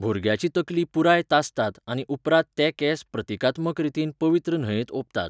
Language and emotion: Goan Konkani, neutral